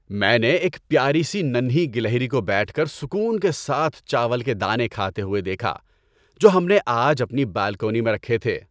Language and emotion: Urdu, happy